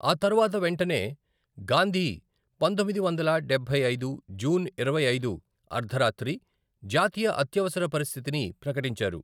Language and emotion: Telugu, neutral